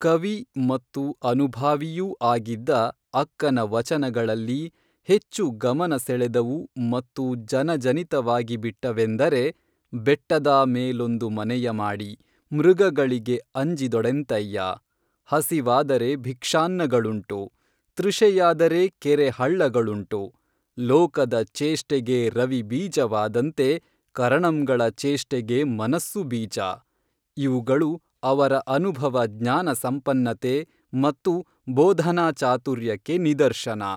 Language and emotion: Kannada, neutral